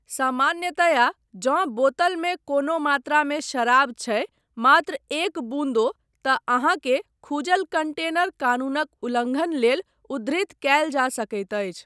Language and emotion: Maithili, neutral